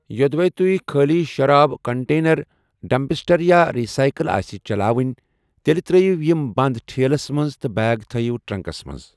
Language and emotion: Kashmiri, neutral